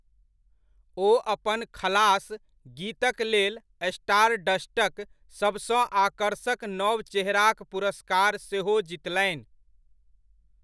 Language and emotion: Maithili, neutral